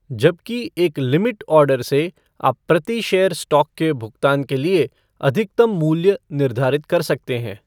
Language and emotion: Hindi, neutral